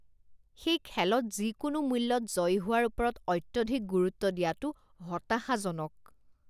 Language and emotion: Assamese, disgusted